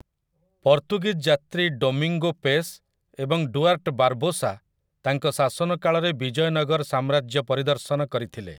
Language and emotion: Odia, neutral